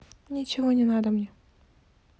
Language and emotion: Russian, neutral